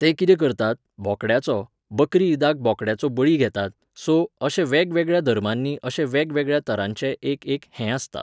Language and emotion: Goan Konkani, neutral